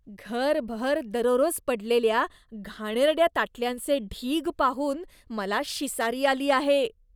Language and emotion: Marathi, disgusted